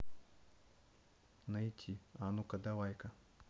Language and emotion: Russian, neutral